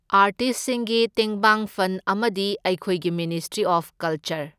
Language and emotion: Manipuri, neutral